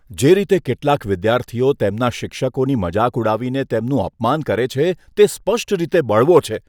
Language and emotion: Gujarati, disgusted